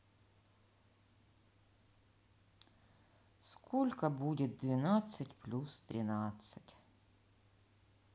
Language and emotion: Russian, sad